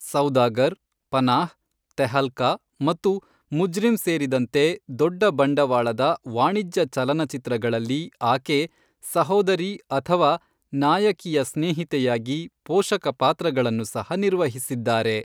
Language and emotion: Kannada, neutral